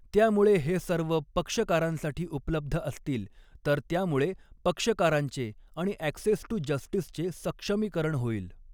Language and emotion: Marathi, neutral